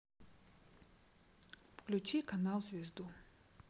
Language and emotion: Russian, neutral